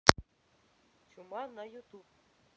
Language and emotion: Russian, neutral